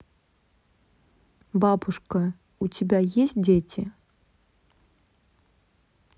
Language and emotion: Russian, neutral